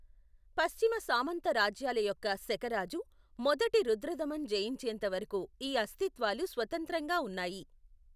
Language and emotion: Telugu, neutral